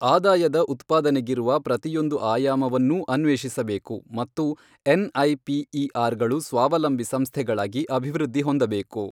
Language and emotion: Kannada, neutral